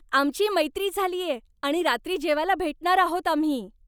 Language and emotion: Marathi, happy